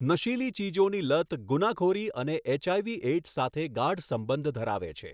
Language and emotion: Gujarati, neutral